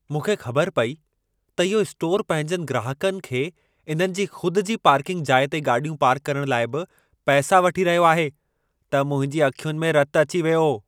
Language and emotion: Sindhi, angry